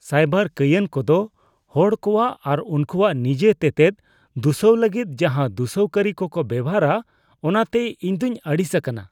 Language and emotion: Santali, disgusted